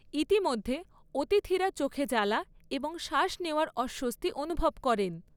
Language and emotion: Bengali, neutral